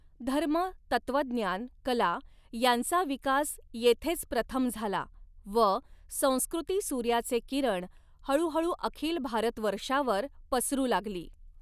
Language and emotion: Marathi, neutral